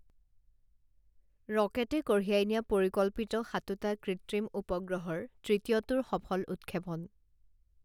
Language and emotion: Assamese, neutral